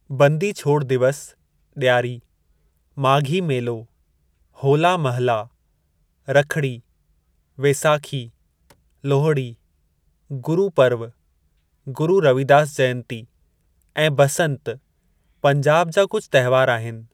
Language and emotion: Sindhi, neutral